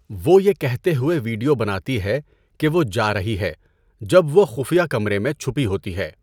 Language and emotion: Urdu, neutral